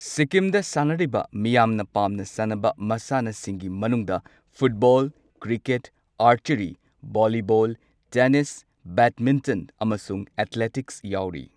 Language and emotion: Manipuri, neutral